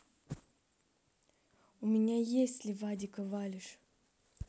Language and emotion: Russian, neutral